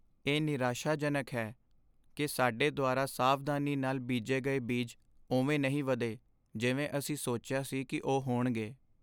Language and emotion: Punjabi, sad